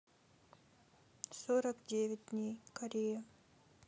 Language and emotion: Russian, neutral